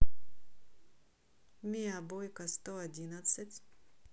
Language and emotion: Russian, neutral